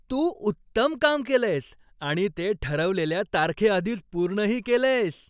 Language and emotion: Marathi, happy